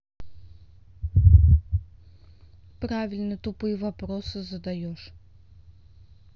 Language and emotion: Russian, neutral